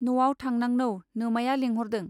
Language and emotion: Bodo, neutral